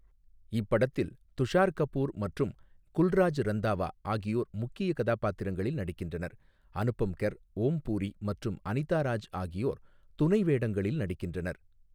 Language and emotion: Tamil, neutral